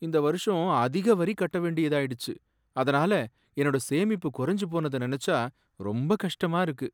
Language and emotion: Tamil, sad